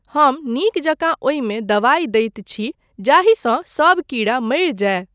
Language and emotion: Maithili, neutral